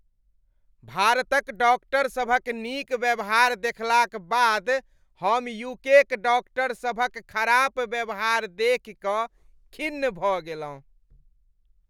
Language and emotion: Maithili, disgusted